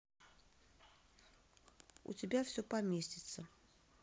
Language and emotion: Russian, neutral